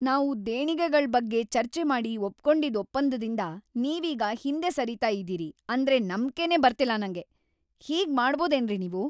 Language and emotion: Kannada, angry